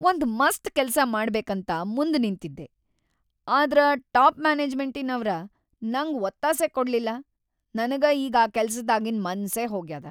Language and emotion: Kannada, sad